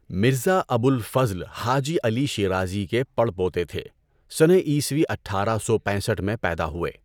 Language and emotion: Urdu, neutral